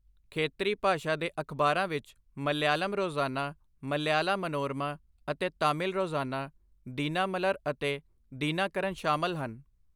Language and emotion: Punjabi, neutral